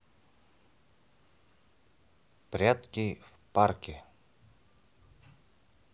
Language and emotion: Russian, neutral